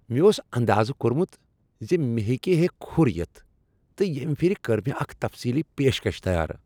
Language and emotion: Kashmiri, happy